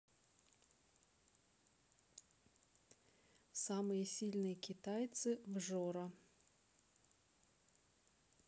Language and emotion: Russian, neutral